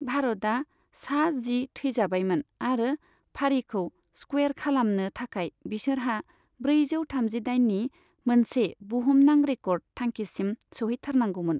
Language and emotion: Bodo, neutral